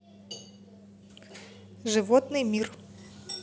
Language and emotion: Russian, neutral